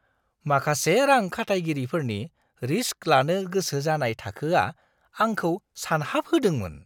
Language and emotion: Bodo, surprised